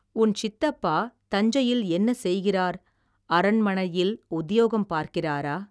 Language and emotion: Tamil, neutral